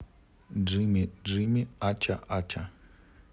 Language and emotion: Russian, neutral